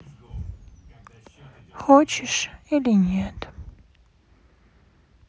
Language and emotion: Russian, sad